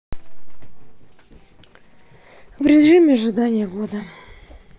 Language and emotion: Russian, sad